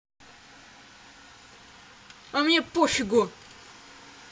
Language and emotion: Russian, angry